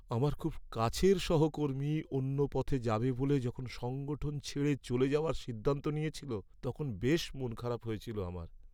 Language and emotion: Bengali, sad